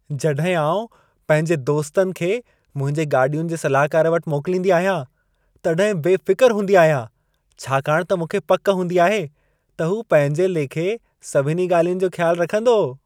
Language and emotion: Sindhi, happy